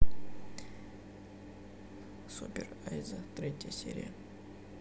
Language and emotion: Russian, neutral